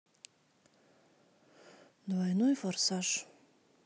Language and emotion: Russian, sad